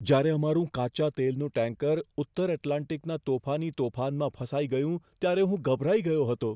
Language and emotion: Gujarati, fearful